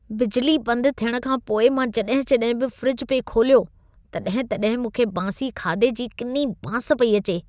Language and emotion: Sindhi, disgusted